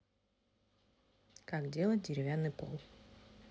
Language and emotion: Russian, neutral